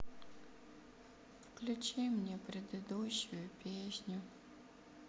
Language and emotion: Russian, sad